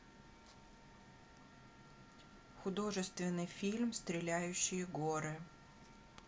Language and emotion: Russian, neutral